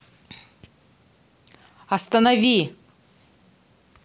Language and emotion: Russian, angry